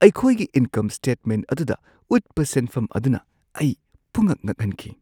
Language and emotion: Manipuri, surprised